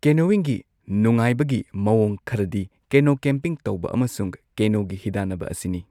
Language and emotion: Manipuri, neutral